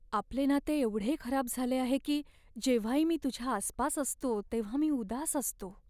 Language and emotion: Marathi, sad